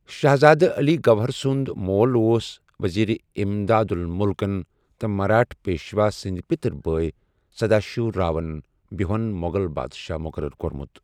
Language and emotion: Kashmiri, neutral